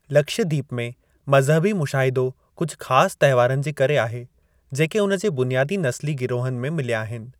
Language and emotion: Sindhi, neutral